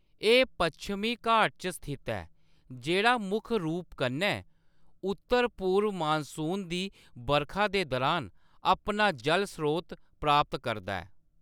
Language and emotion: Dogri, neutral